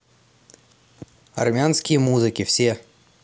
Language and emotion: Russian, neutral